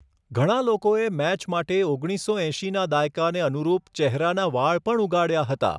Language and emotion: Gujarati, neutral